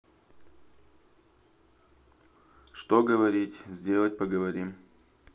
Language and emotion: Russian, neutral